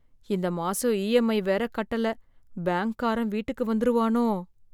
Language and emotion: Tamil, fearful